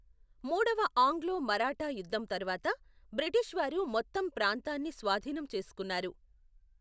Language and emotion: Telugu, neutral